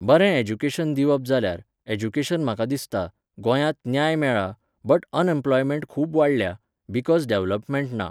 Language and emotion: Goan Konkani, neutral